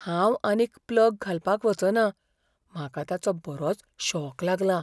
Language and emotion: Goan Konkani, fearful